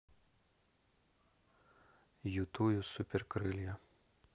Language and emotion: Russian, neutral